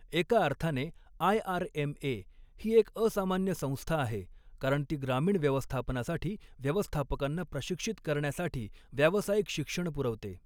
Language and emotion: Marathi, neutral